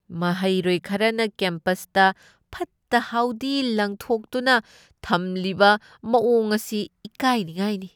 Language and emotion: Manipuri, disgusted